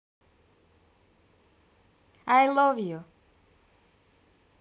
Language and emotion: Russian, positive